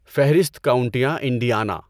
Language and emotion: Urdu, neutral